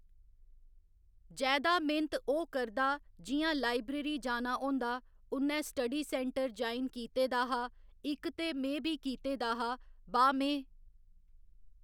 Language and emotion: Dogri, neutral